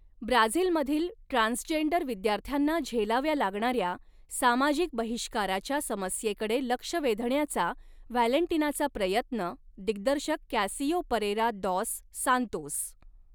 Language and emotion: Marathi, neutral